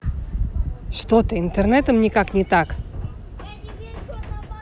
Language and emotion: Russian, angry